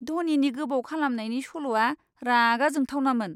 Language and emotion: Bodo, disgusted